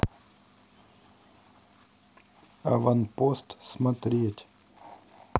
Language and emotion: Russian, neutral